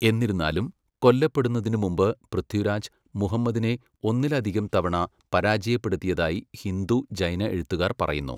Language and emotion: Malayalam, neutral